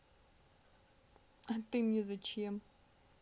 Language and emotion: Russian, sad